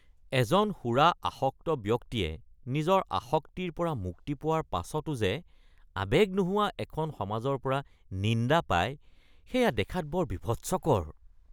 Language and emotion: Assamese, disgusted